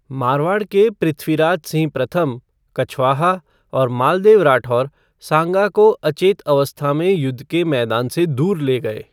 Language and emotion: Hindi, neutral